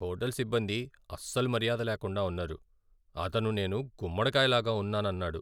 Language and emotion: Telugu, sad